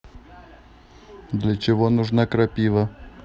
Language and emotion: Russian, neutral